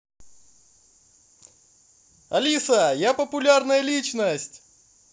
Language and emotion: Russian, positive